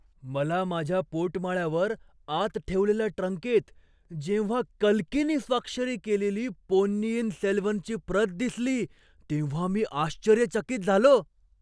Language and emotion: Marathi, surprised